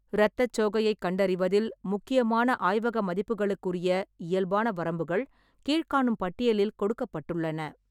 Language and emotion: Tamil, neutral